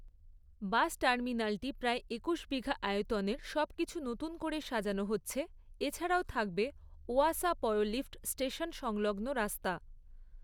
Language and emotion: Bengali, neutral